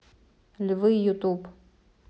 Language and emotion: Russian, neutral